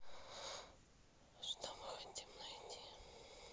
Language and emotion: Russian, neutral